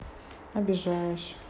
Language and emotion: Russian, neutral